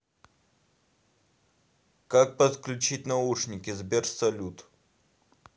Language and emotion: Russian, neutral